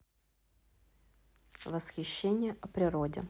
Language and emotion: Russian, neutral